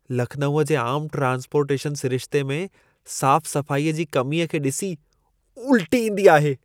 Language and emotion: Sindhi, disgusted